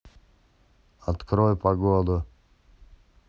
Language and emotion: Russian, neutral